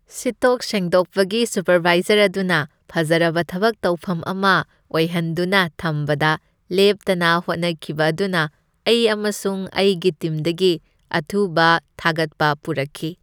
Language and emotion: Manipuri, happy